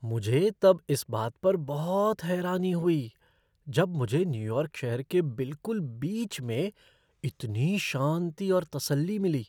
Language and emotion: Hindi, surprised